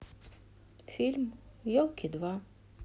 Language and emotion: Russian, sad